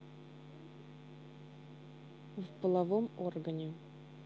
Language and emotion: Russian, neutral